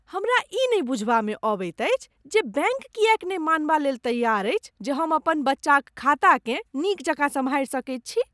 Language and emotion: Maithili, disgusted